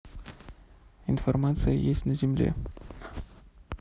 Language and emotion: Russian, neutral